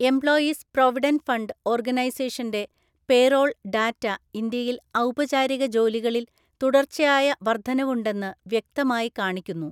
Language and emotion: Malayalam, neutral